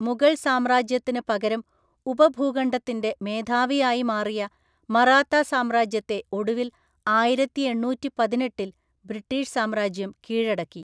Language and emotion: Malayalam, neutral